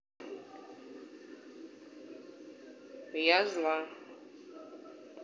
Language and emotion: Russian, neutral